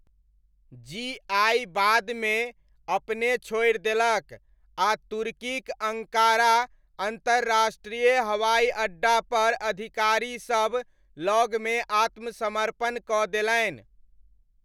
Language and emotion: Maithili, neutral